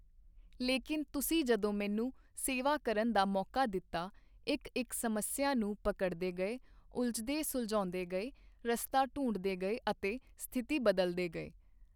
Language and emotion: Punjabi, neutral